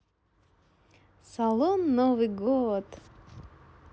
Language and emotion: Russian, positive